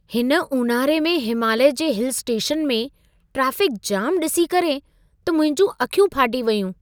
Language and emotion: Sindhi, surprised